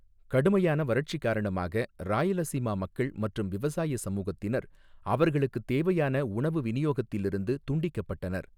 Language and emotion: Tamil, neutral